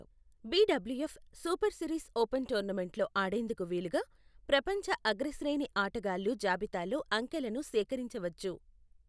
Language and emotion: Telugu, neutral